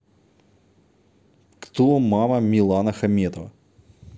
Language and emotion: Russian, neutral